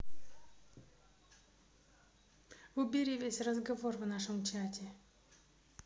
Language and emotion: Russian, neutral